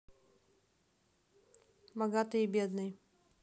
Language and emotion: Russian, neutral